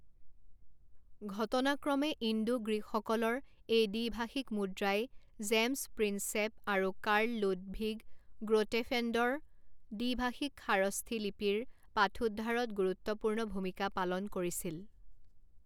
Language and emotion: Assamese, neutral